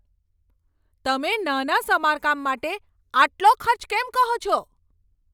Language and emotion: Gujarati, angry